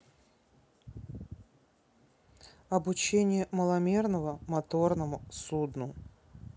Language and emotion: Russian, neutral